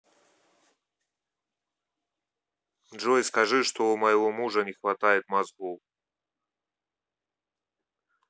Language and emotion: Russian, neutral